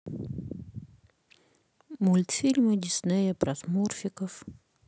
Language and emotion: Russian, sad